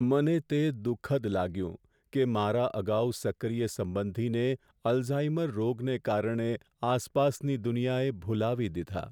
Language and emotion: Gujarati, sad